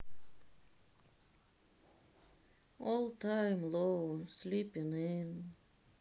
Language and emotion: Russian, sad